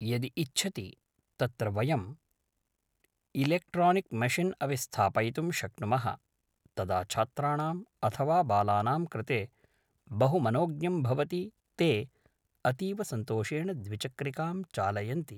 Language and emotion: Sanskrit, neutral